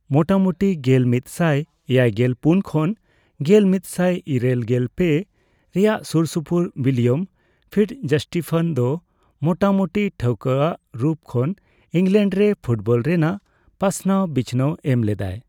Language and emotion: Santali, neutral